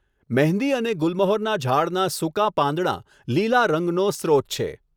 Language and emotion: Gujarati, neutral